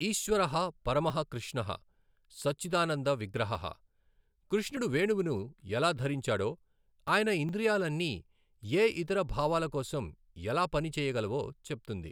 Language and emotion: Telugu, neutral